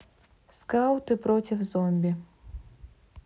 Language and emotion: Russian, neutral